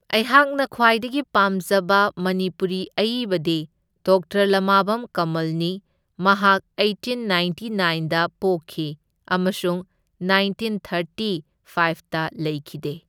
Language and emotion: Manipuri, neutral